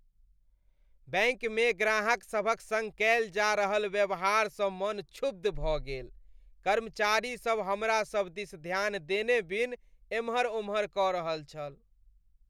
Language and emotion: Maithili, disgusted